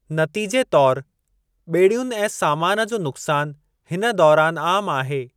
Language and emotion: Sindhi, neutral